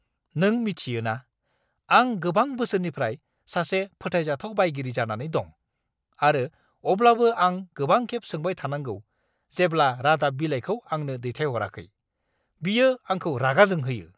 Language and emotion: Bodo, angry